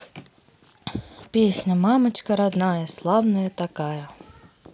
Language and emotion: Russian, neutral